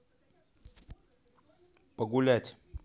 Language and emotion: Russian, neutral